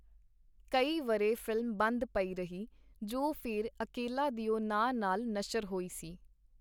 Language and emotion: Punjabi, neutral